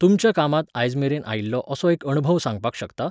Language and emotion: Goan Konkani, neutral